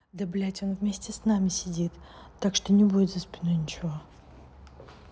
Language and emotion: Russian, angry